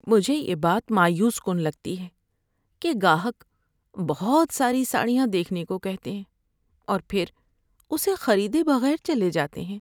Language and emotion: Urdu, sad